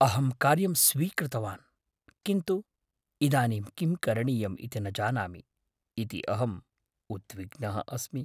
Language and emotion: Sanskrit, fearful